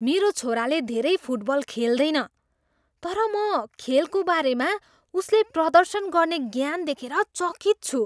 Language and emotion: Nepali, surprised